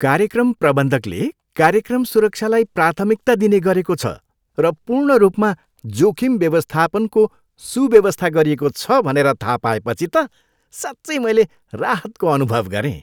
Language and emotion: Nepali, happy